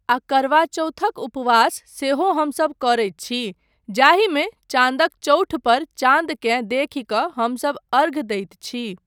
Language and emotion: Maithili, neutral